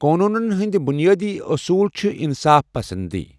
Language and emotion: Kashmiri, neutral